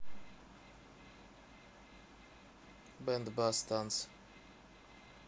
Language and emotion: Russian, neutral